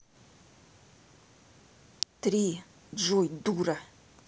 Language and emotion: Russian, angry